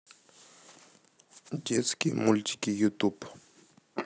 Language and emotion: Russian, neutral